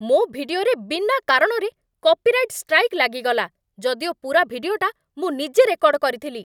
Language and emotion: Odia, angry